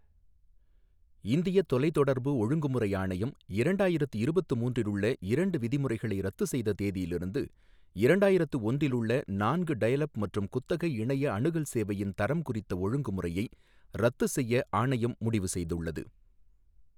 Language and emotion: Tamil, neutral